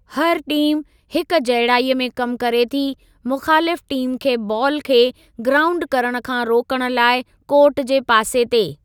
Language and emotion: Sindhi, neutral